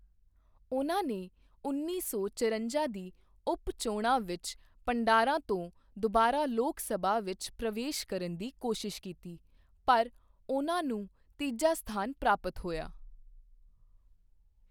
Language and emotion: Punjabi, neutral